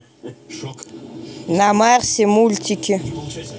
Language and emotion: Russian, neutral